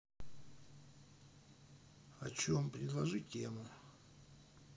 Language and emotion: Russian, neutral